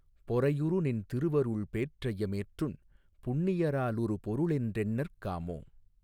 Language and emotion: Tamil, neutral